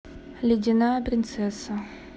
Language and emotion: Russian, neutral